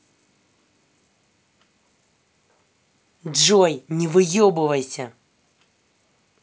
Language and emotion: Russian, angry